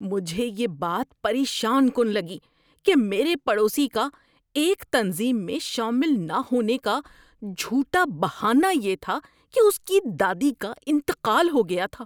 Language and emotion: Urdu, disgusted